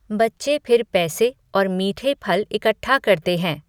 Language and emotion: Hindi, neutral